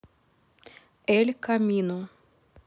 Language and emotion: Russian, neutral